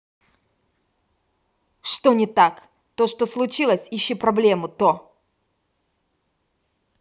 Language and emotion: Russian, angry